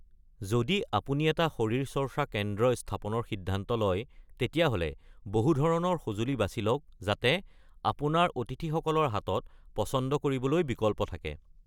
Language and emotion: Assamese, neutral